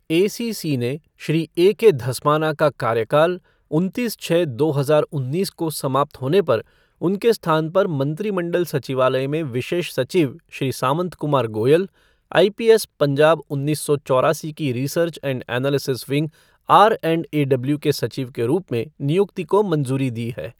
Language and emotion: Hindi, neutral